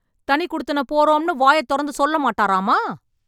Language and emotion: Tamil, angry